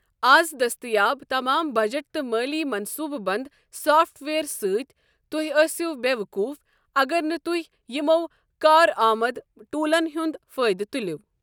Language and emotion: Kashmiri, neutral